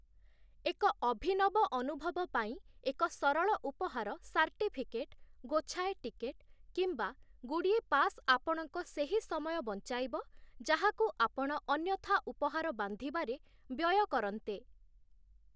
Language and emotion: Odia, neutral